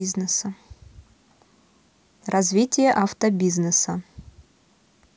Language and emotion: Russian, neutral